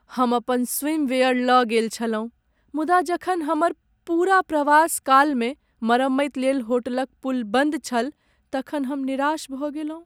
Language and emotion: Maithili, sad